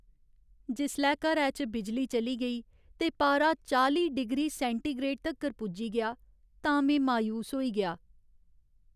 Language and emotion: Dogri, sad